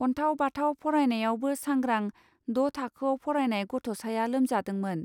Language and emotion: Bodo, neutral